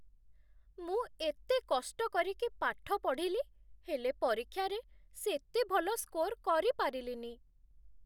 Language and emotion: Odia, sad